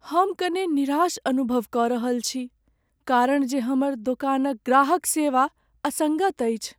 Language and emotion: Maithili, sad